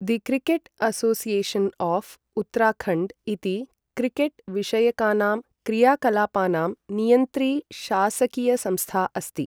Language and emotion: Sanskrit, neutral